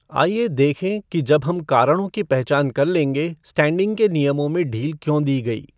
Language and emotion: Hindi, neutral